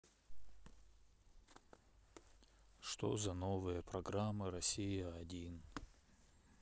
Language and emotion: Russian, sad